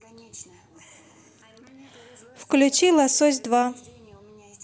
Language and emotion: Russian, neutral